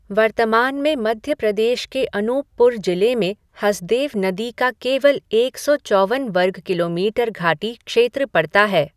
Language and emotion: Hindi, neutral